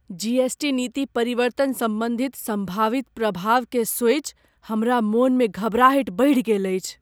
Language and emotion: Maithili, fearful